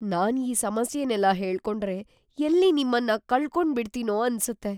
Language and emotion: Kannada, fearful